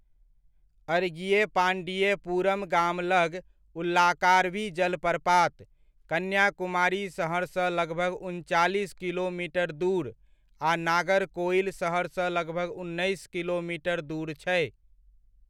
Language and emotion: Maithili, neutral